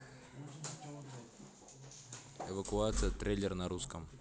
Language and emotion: Russian, neutral